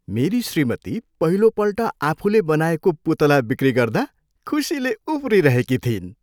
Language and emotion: Nepali, happy